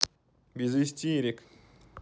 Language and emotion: Russian, neutral